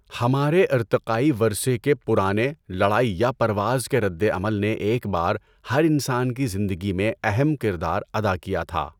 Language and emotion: Urdu, neutral